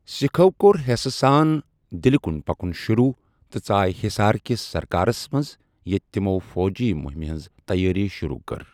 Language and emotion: Kashmiri, neutral